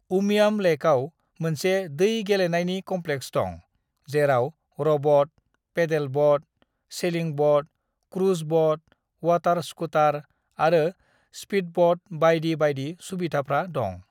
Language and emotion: Bodo, neutral